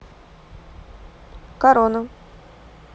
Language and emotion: Russian, neutral